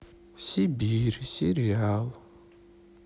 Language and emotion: Russian, sad